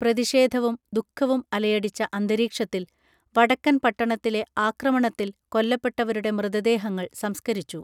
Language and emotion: Malayalam, neutral